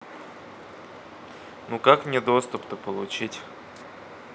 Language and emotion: Russian, neutral